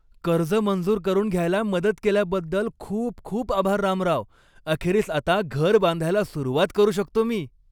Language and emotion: Marathi, happy